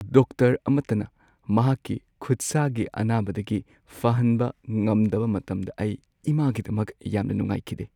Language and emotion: Manipuri, sad